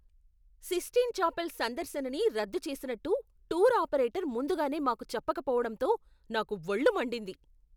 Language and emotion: Telugu, angry